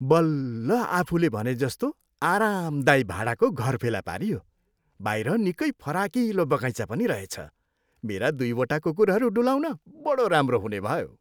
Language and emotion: Nepali, happy